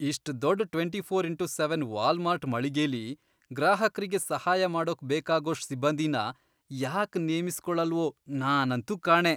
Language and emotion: Kannada, disgusted